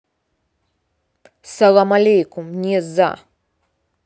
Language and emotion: Russian, angry